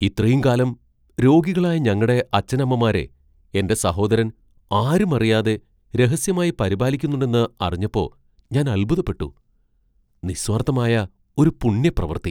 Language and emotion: Malayalam, surprised